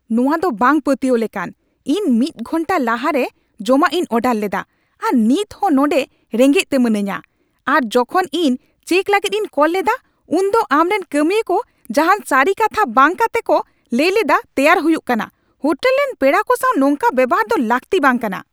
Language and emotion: Santali, angry